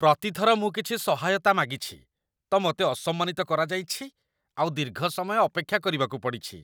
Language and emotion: Odia, disgusted